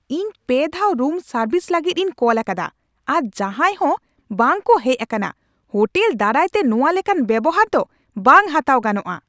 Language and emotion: Santali, angry